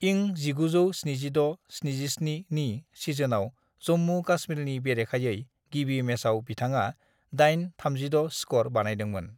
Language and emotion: Bodo, neutral